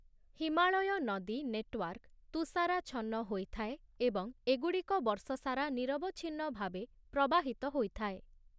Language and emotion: Odia, neutral